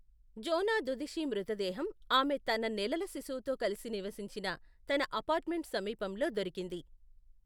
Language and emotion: Telugu, neutral